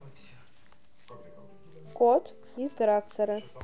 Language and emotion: Russian, neutral